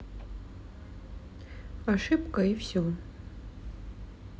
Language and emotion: Russian, neutral